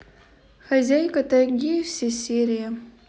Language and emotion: Russian, neutral